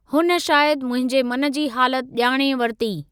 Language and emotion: Sindhi, neutral